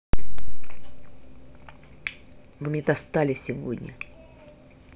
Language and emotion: Russian, angry